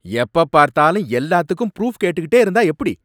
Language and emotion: Tamil, angry